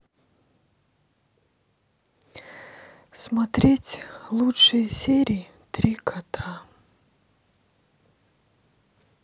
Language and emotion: Russian, sad